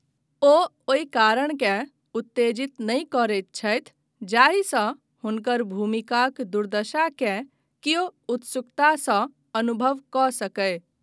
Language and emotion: Maithili, neutral